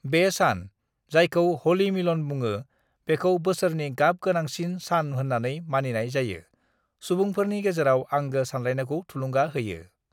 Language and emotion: Bodo, neutral